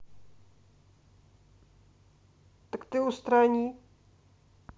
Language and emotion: Russian, neutral